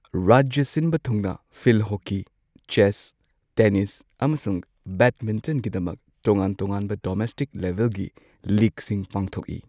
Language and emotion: Manipuri, neutral